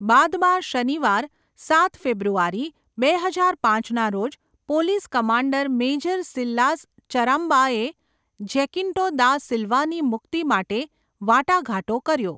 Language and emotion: Gujarati, neutral